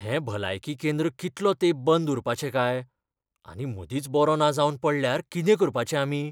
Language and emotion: Goan Konkani, fearful